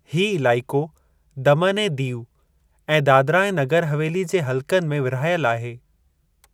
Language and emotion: Sindhi, neutral